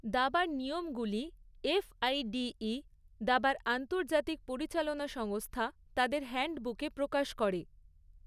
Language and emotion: Bengali, neutral